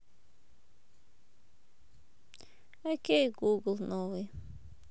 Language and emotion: Russian, sad